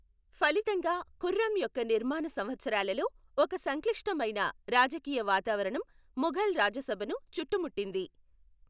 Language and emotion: Telugu, neutral